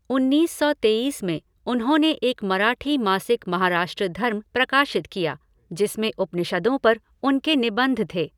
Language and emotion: Hindi, neutral